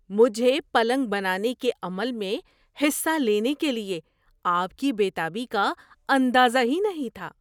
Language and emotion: Urdu, surprised